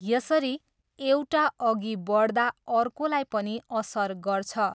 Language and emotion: Nepali, neutral